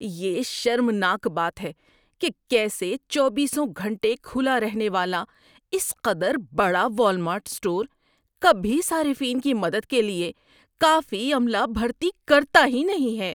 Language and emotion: Urdu, disgusted